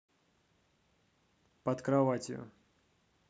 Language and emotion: Russian, neutral